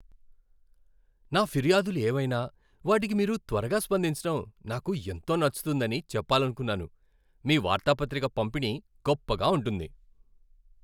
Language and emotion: Telugu, happy